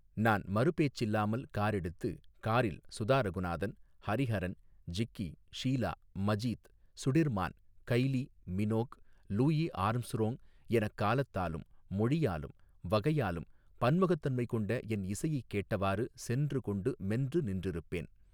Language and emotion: Tamil, neutral